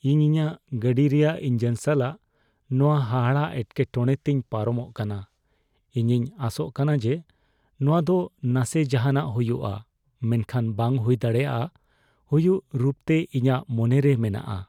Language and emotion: Santali, fearful